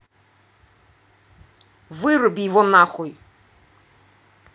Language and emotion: Russian, angry